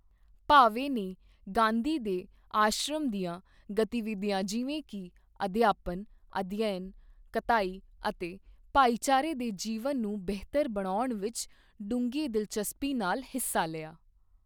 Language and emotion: Punjabi, neutral